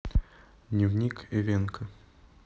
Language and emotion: Russian, neutral